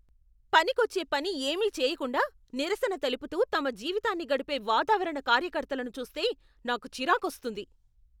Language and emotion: Telugu, angry